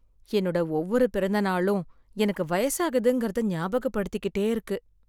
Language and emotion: Tamil, sad